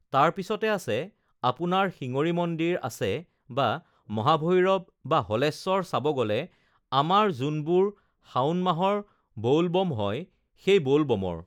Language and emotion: Assamese, neutral